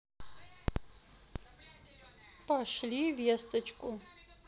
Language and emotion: Russian, neutral